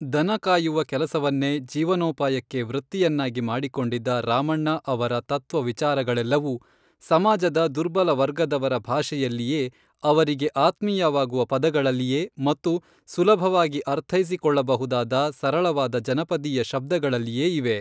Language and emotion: Kannada, neutral